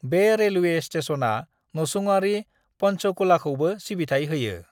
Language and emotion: Bodo, neutral